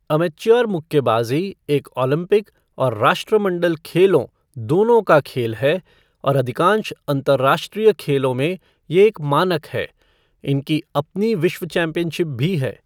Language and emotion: Hindi, neutral